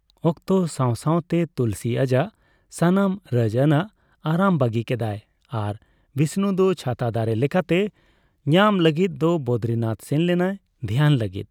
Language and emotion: Santali, neutral